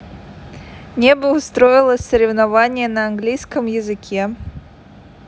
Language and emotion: Russian, neutral